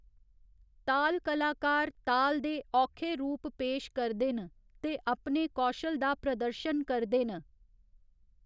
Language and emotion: Dogri, neutral